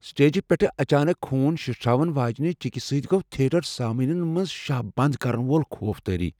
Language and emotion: Kashmiri, fearful